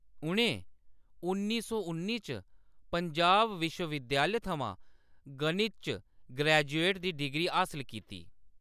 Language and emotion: Dogri, neutral